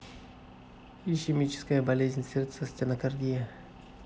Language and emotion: Russian, neutral